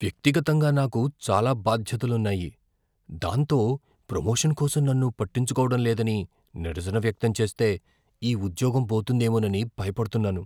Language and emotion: Telugu, fearful